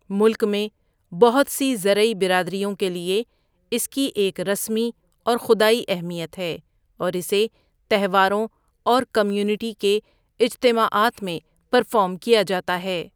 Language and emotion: Urdu, neutral